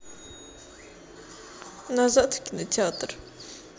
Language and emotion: Russian, sad